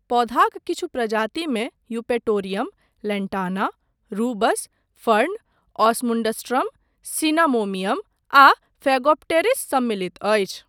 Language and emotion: Maithili, neutral